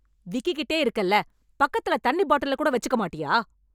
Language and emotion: Tamil, angry